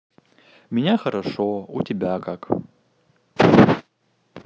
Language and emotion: Russian, neutral